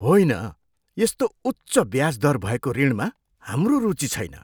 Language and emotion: Nepali, disgusted